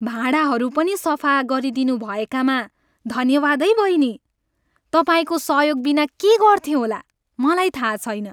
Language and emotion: Nepali, happy